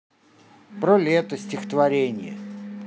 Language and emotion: Russian, neutral